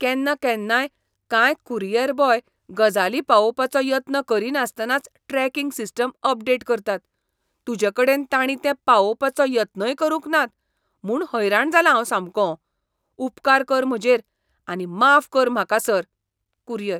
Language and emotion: Goan Konkani, disgusted